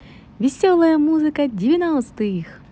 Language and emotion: Russian, positive